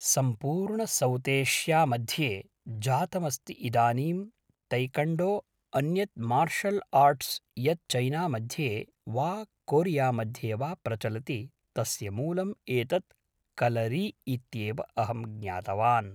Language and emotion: Sanskrit, neutral